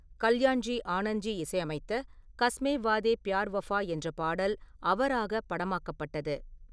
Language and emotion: Tamil, neutral